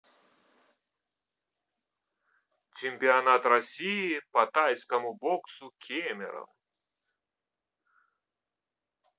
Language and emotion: Russian, neutral